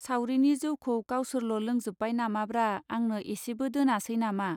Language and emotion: Bodo, neutral